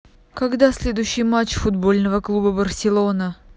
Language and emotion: Russian, neutral